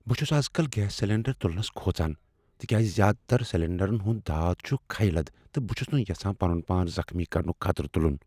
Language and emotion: Kashmiri, fearful